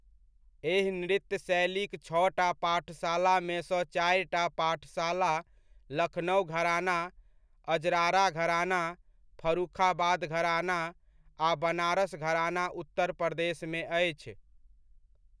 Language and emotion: Maithili, neutral